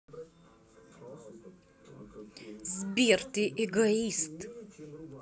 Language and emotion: Russian, angry